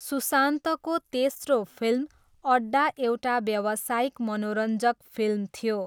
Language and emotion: Nepali, neutral